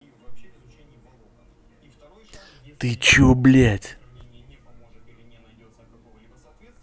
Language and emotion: Russian, angry